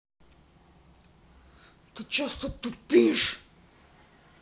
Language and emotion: Russian, angry